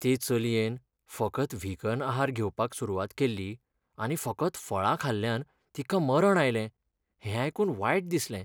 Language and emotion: Goan Konkani, sad